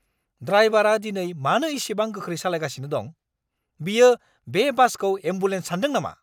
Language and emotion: Bodo, angry